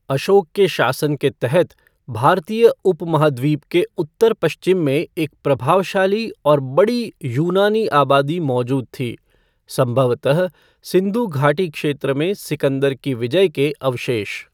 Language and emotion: Hindi, neutral